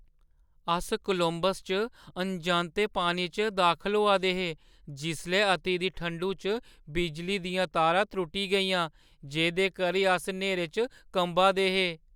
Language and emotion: Dogri, fearful